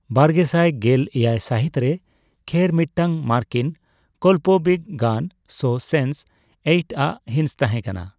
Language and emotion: Santali, neutral